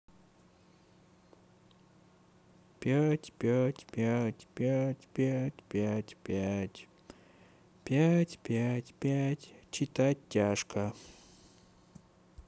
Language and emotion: Russian, sad